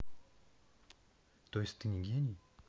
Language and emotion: Russian, neutral